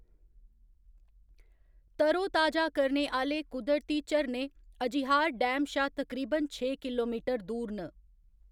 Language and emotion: Dogri, neutral